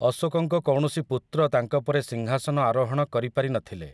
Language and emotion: Odia, neutral